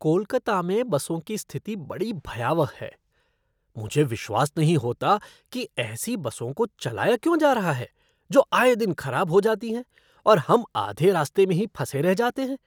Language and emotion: Hindi, disgusted